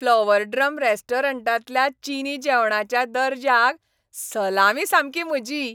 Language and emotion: Goan Konkani, happy